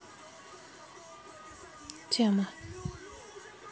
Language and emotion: Russian, neutral